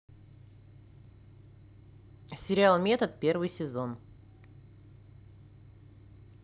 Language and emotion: Russian, neutral